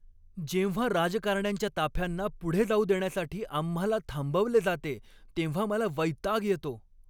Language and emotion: Marathi, angry